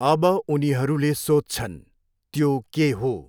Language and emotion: Nepali, neutral